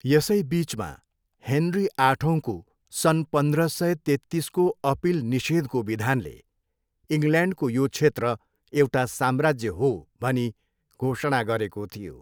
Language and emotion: Nepali, neutral